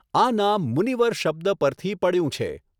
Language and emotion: Gujarati, neutral